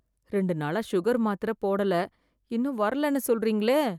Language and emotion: Tamil, fearful